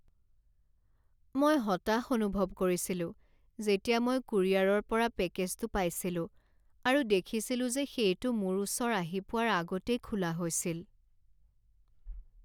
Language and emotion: Assamese, sad